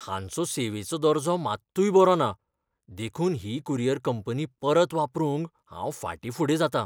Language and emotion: Goan Konkani, fearful